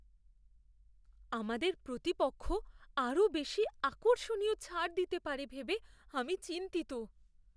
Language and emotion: Bengali, fearful